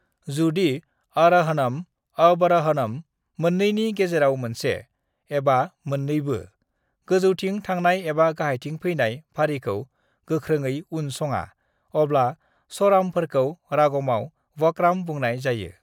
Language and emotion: Bodo, neutral